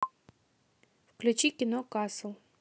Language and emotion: Russian, neutral